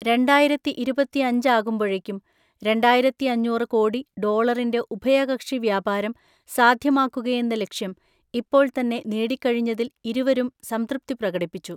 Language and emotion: Malayalam, neutral